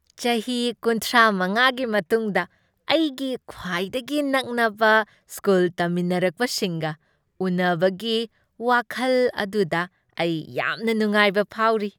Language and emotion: Manipuri, happy